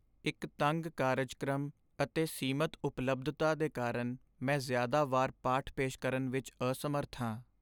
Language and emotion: Punjabi, sad